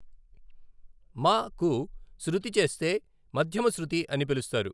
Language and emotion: Telugu, neutral